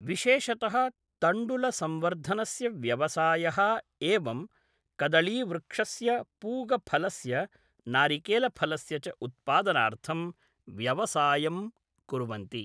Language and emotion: Sanskrit, neutral